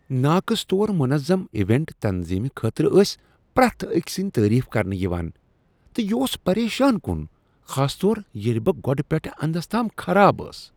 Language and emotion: Kashmiri, disgusted